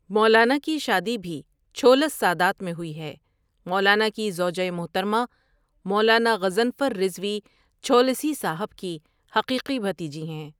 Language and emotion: Urdu, neutral